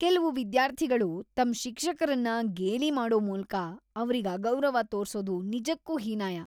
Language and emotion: Kannada, disgusted